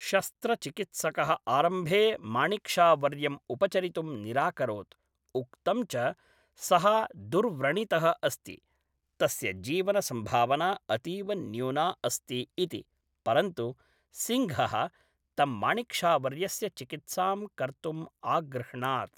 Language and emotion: Sanskrit, neutral